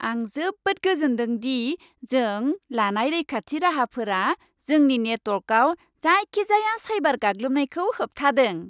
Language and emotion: Bodo, happy